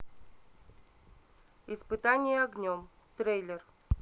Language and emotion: Russian, neutral